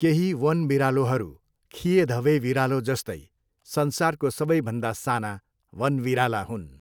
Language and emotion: Nepali, neutral